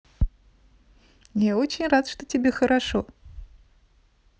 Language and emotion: Russian, positive